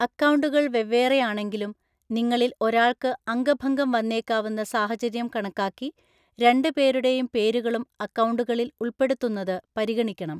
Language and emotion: Malayalam, neutral